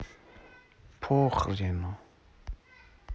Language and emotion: Russian, sad